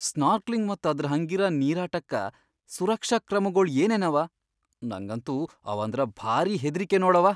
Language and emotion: Kannada, fearful